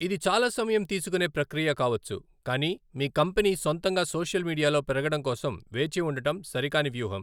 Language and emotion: Telugu, neutral